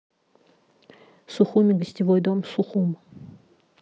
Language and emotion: Russian, neutral